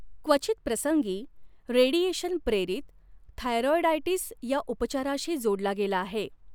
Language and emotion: Marathi, neutral